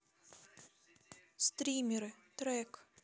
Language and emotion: Russian, neutral